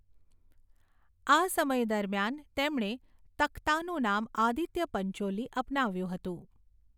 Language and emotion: Gujarati, neutral